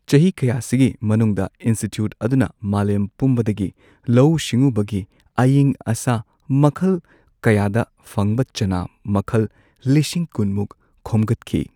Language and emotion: Manipuri, neutral